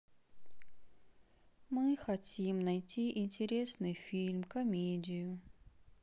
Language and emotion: Russian, sad